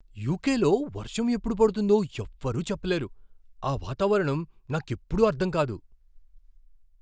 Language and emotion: Telugu, surprised